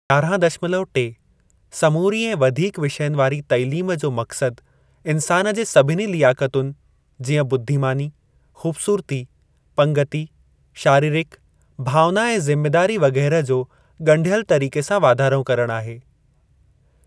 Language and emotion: Sindhi, neutral